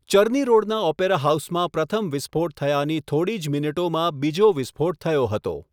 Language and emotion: Gujarati, neutral